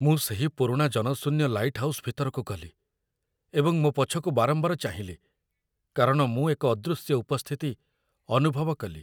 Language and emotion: Odia, fearful